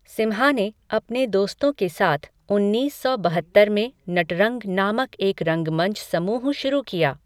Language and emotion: Hindi, neutral